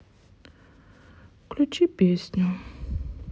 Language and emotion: Russian, sad